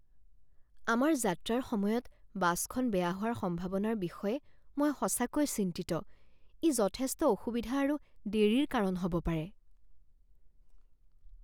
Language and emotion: Assamese, fearful